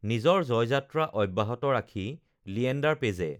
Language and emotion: Assamese, neutral